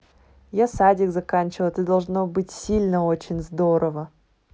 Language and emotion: Russian, neutral